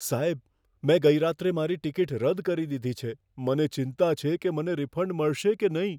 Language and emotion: Gujarati, fearful